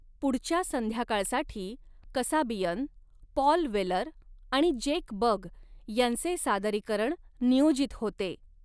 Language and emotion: Marathi, neutral